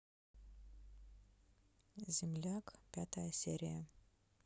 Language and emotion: Russian, neutral